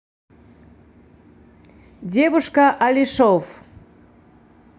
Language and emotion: Russian, neutral